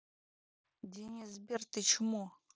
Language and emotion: Russian, angry